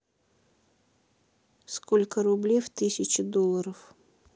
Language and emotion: Russian, neutral